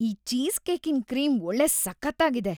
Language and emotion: Kannada, happy